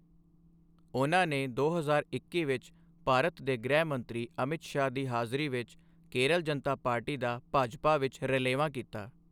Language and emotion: Punjabi, neutral